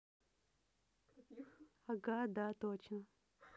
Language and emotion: Russian, positive